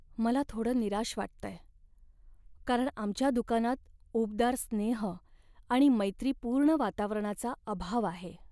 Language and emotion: Marathi, sad